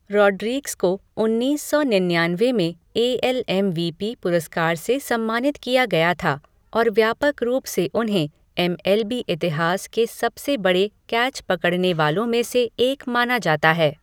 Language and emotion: Hindi, neutral